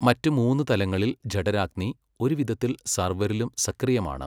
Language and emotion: Malayalam, neutral